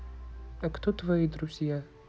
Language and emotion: Russian, neutral